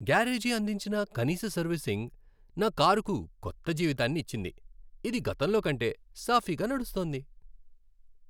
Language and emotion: Telugu, happy